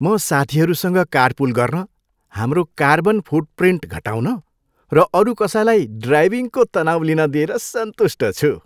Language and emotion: Nepali, happy